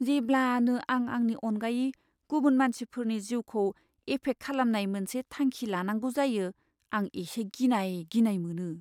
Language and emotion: Bodo, fearful